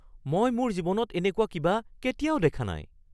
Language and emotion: Assamese, surprised